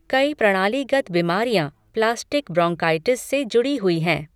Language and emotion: Hindi, neutral